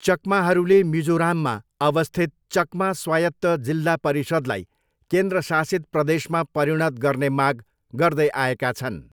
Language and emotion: Nepali, neutral